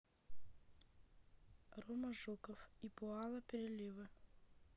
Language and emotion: Russian, neutral